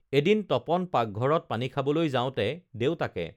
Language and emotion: Assamese, neutral